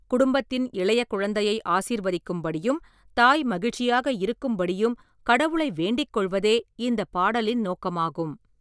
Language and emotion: Tamil, neutral